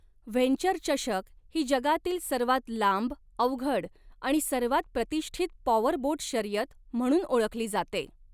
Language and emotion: Marathi, neutral